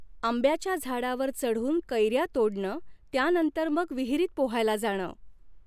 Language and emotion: Marathi, neutral